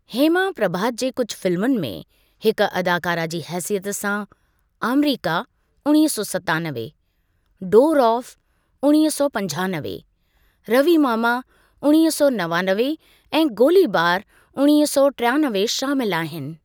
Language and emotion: Sindhi, neutral